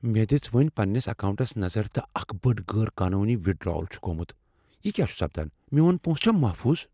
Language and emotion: Kashmiri, fearful